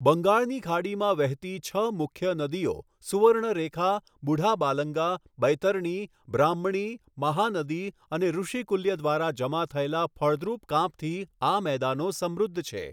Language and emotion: Gujarati, neutral